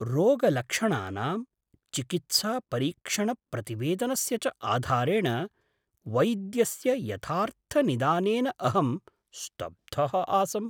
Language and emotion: Sanskrit, surprised